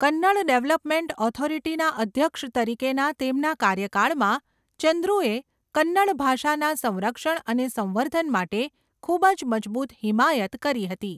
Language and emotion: Gujarati, neutral